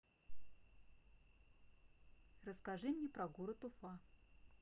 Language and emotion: Russian, neutral